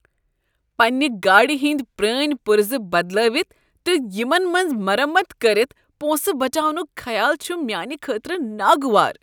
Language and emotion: Kashmiri, disgusted